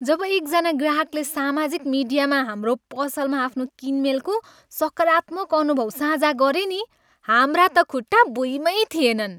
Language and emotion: Nepali, happy